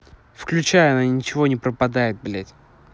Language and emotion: Russian, angry